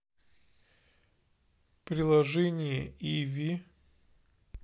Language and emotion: Russian, neutral